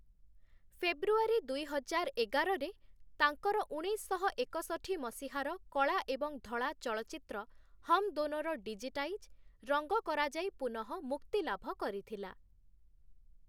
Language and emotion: Odia, neutral